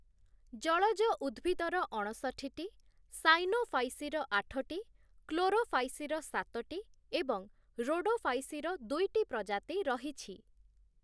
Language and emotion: Odia, neutral